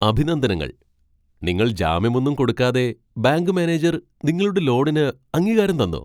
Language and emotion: Malayalam, surprised